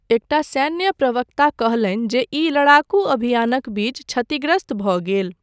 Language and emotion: Maithili, neutral